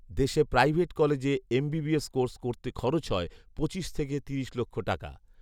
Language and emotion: Bengali, neutral